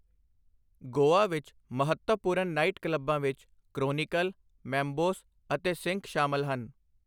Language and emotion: Punjabi, neutral